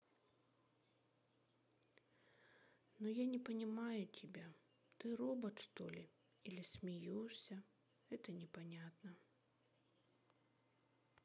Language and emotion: Russian, sad